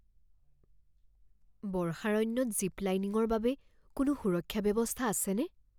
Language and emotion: Assamese, fearful